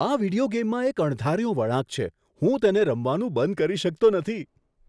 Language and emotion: Gujarati, surprised